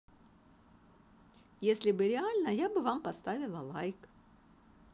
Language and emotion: Russian, positive